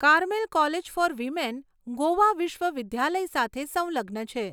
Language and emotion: Gujarati, neutral